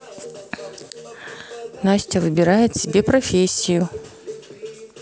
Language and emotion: Russian, neutral